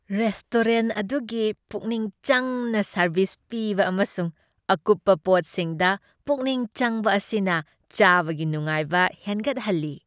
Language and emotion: Manipuri, happy